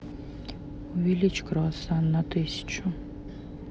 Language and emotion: Russian, neutral